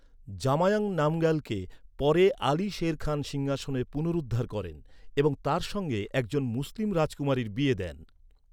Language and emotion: Bengali, neutral